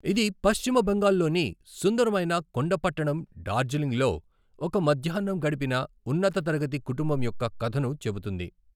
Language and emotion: Telugu, neutral